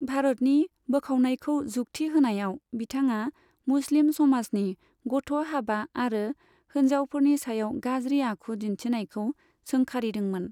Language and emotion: Bodo, neutral